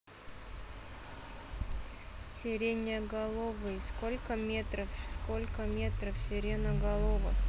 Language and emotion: Russian, neutral